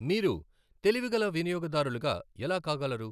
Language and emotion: Telugu, neutral